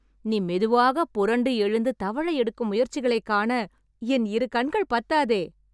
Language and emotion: Tamil, happy